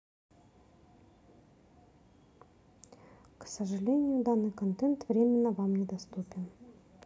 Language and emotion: Russian, neutral